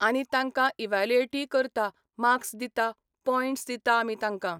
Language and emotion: Goan Konkani, neutral